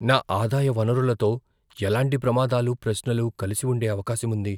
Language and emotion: Telugu, fearful